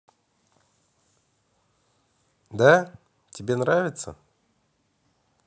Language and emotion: Russian, positive